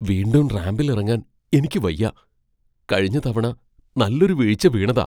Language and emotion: Malayalam, fearful